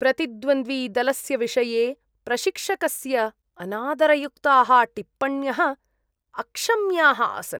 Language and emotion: Sanskrit, disgusted